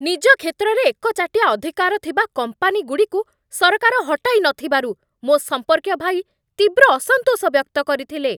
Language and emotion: Odia, angry